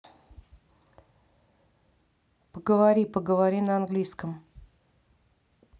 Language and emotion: Russian, neutral